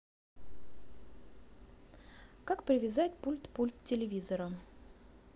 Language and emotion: Russian, neutral